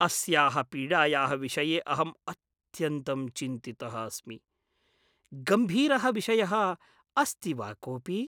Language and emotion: Sanskrit, fearful